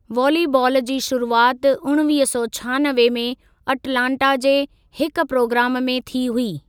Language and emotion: Sindhi, neutral